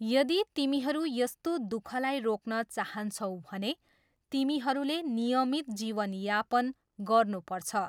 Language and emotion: Nepali, neutral